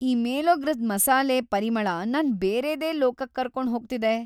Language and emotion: Kannada, happy